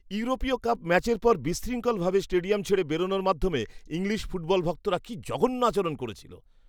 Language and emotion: Bengali, disgusted